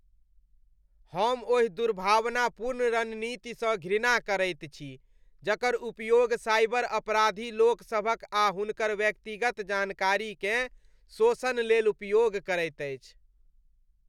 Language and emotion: Maithili, disgusted